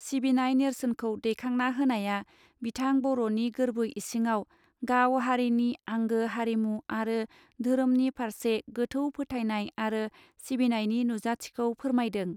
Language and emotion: Bodo, neutral